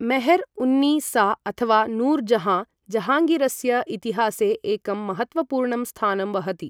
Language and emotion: Sanskrit, neutral